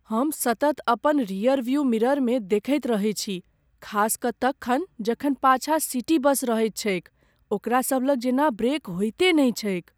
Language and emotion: Maithili, fearful